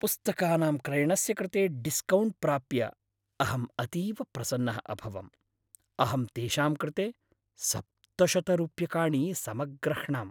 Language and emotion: Sanskrit, happy